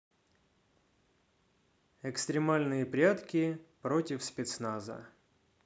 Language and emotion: Russian, neutral